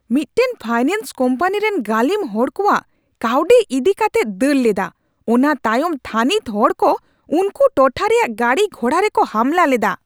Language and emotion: Santali, angry